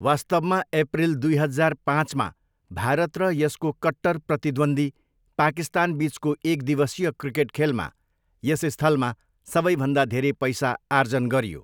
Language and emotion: Nepali, neutral